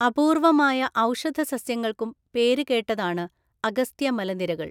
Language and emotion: Malayalam, neutral